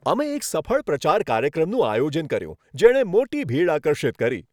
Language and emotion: Gujarati, happy